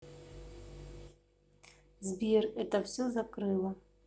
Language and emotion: Russian, neutral